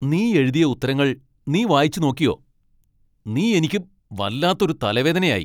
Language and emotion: Malayalam, angry